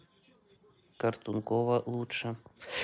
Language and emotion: Russian, neutral